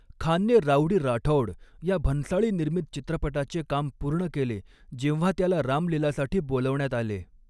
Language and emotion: Marathi, neutral